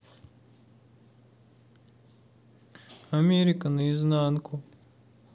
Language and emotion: Russian, sad